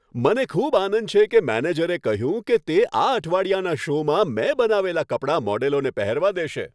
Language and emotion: Gujarati, happy